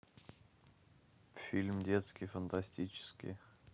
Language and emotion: Russian, neutral